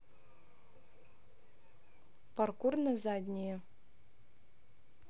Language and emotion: Russian, neutral